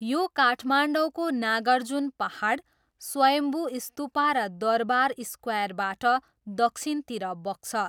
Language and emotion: Nepali, neutral